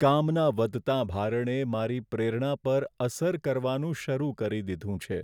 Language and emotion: Gujarati, sad